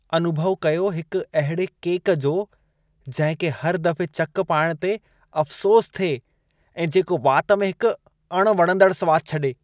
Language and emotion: Sindhi, disgusted